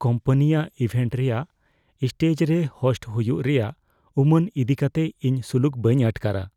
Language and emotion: Santali, fearful